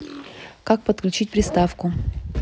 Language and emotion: Russian, neutral